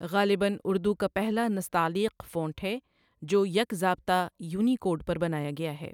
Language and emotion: Urdu, neutral